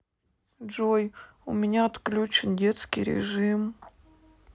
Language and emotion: Russian, sad